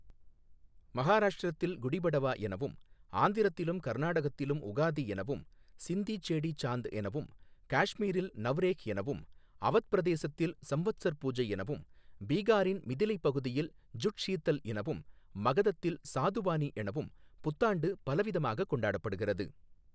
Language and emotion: Tamil, neutral